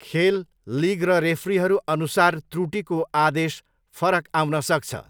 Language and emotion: Nepali, neutral